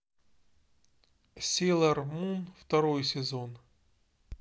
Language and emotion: Russian, neutral